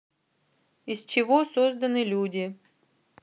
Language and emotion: Russian, neutral